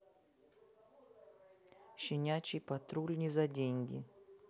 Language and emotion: Russian, neutral